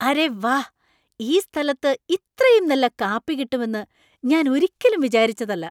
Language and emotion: Malayalam, surprised